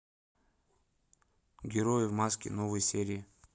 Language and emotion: Russian, neutral